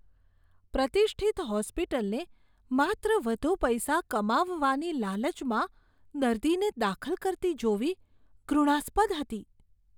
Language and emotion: Gujarati, disgusted